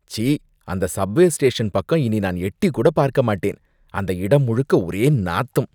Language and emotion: Tamil, disgusted